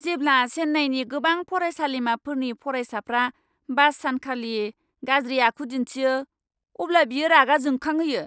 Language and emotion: Bodo, angry